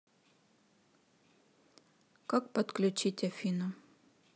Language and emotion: Russian, neutral